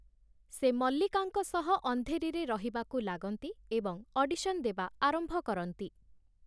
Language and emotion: Odia, neutral